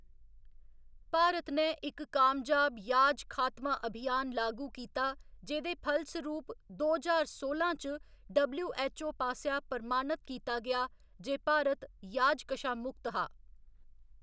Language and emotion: Dogri, neutral